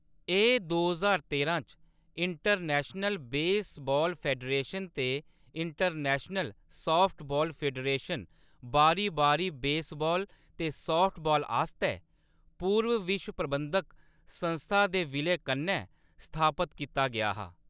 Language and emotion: Dogri, neutral